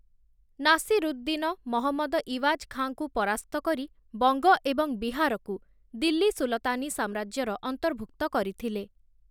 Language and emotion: Odia, neutral